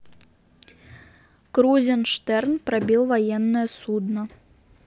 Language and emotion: Russian, neutral